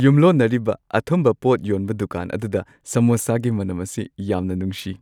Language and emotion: Manipuri, happy